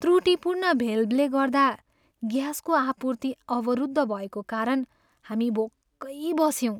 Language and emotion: Nepali, sad